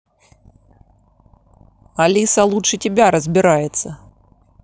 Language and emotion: Russian, angry